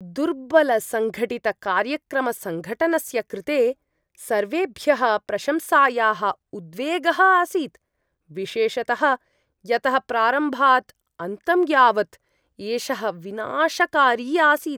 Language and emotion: Sanskrit, disgusted